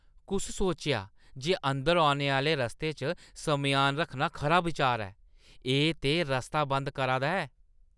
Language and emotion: Dogri, disgusted